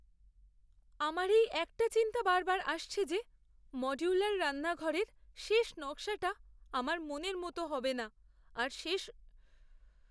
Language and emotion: Bengali, fearful